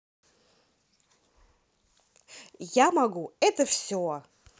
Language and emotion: Russian, positive